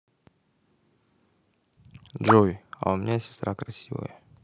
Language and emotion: Russian, neutral